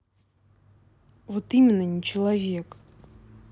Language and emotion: Russian, angry